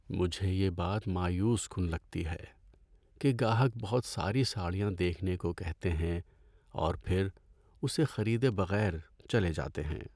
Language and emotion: Urdu, sad